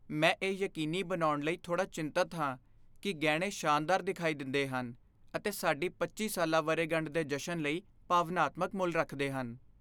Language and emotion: Punjabi, fearful